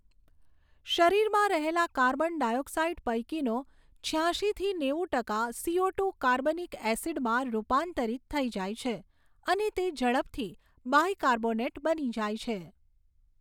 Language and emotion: Gujarati, neutral